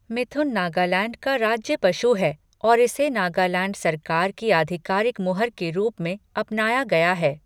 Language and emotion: Hindi, neutral